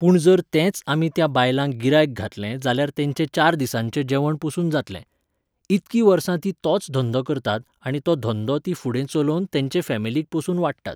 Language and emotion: Goan Konkani, neutral